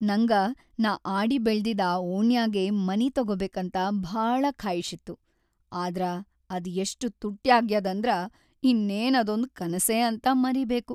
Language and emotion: Kannada, sad